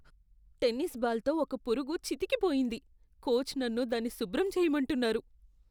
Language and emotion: Telugu, disgusted